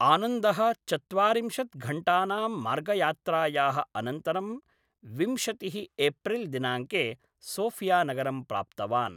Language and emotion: Sanskrit, neutral